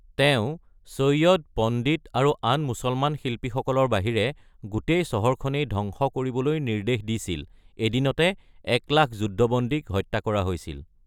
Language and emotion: Assamese, neutral